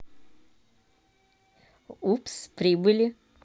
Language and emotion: Russian, positive